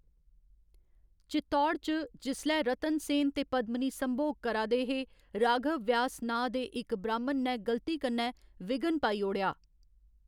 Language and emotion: Dogri, neutral